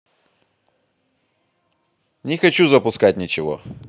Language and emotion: Russian, angry